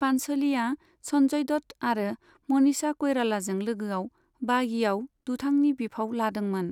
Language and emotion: Bodo, neutral